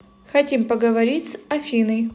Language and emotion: Russian, neutral